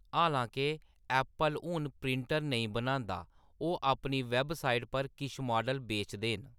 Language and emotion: Dogri, neutral